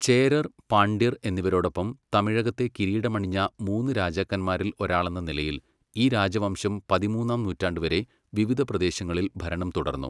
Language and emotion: Malayalam, neutral